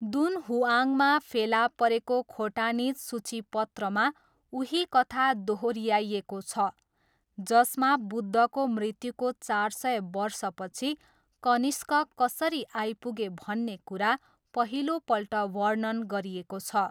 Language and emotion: Nepali, neutral